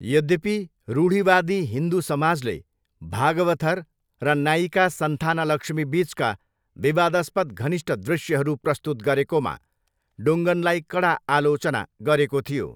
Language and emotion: Nepali, neutral